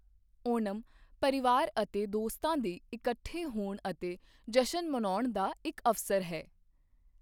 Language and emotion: Punjabi, neutral